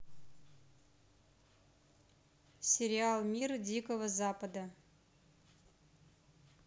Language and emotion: Russian, neutral